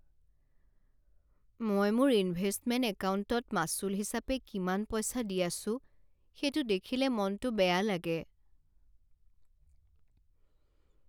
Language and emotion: Assamese, sad